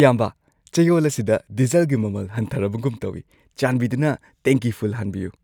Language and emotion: Manipuri, happy